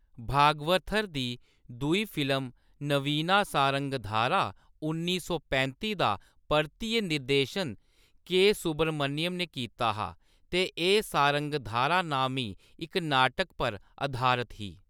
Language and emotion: Dogri, neutral